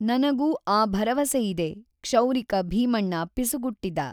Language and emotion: Kannada, neutral